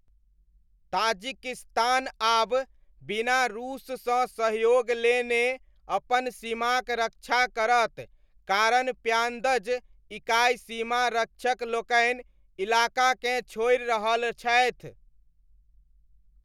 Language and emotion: Maithili, neutral